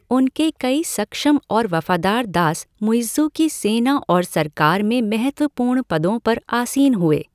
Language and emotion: Hindi, neutral